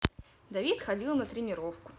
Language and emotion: Russian, neutral